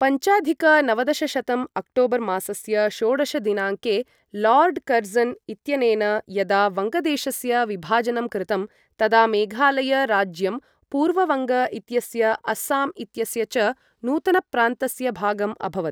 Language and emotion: Sanskrit, neutral